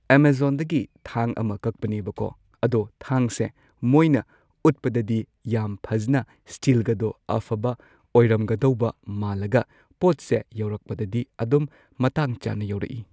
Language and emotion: Manipuri, neutral